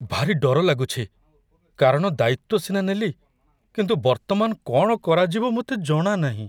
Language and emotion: Odia, fearful